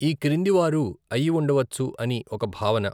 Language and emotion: Telugu, neutral